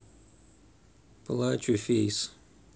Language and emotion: Russian, neutral